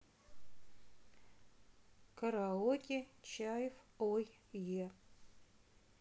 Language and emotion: Russian, neutral